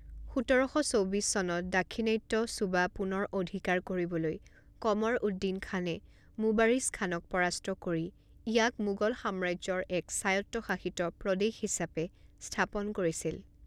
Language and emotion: Assamese, neutral